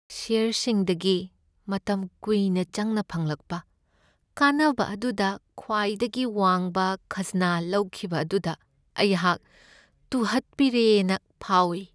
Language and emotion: Manipuri, sad